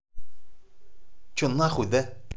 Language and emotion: Russian, angry